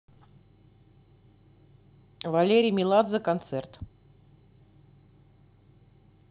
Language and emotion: Russian, neutral